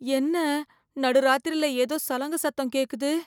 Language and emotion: Tamil, fearful